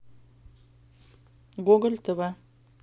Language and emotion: Russian, neutral